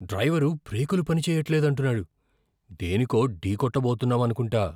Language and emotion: Telugu, fearful